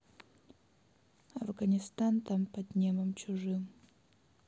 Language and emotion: Russian, neutral